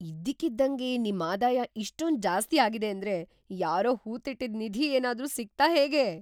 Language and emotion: Kannada, surprised